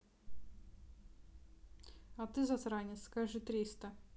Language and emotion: Russian, neutral